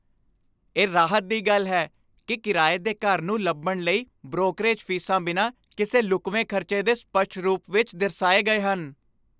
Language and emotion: Punjabi, happy